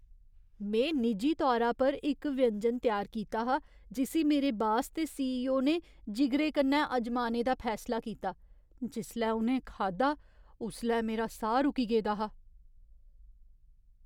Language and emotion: Dogri, fearful